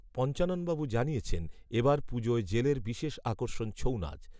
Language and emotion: Bengali, neutral